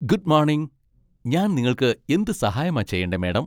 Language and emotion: Malayalam, happy